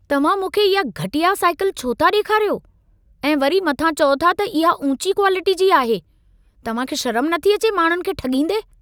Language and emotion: Sindhi, angry